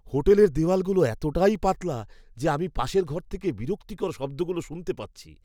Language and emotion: Bengali, disgusted